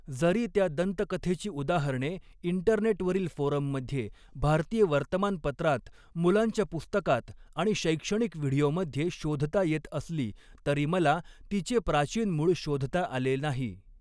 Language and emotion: Marathi, neutral